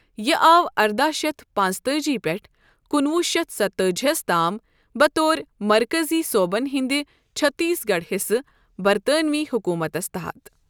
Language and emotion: Kashmiri, neutral